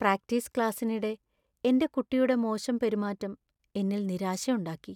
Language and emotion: Malayalam, sad